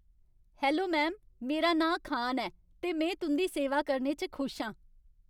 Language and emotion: Dogri, happy